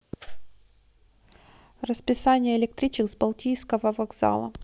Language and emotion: Russian, neutral